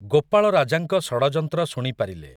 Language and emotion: Odia, neutral